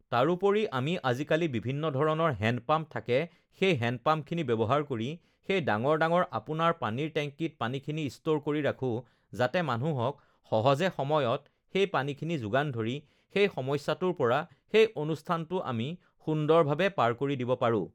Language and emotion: Assamese, neutral